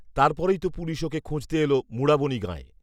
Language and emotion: Bengali, neutral